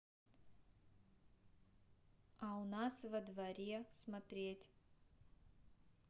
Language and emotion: Russian, neutral